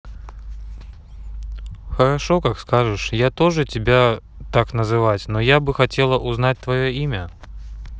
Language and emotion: Russian, neutral